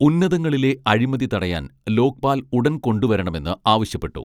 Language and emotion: Malayalam, neutral